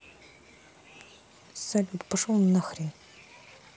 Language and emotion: Russian, angry